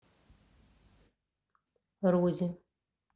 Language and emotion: Russian, neutral